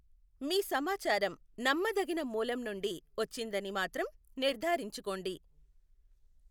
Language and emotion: Telugu, neutral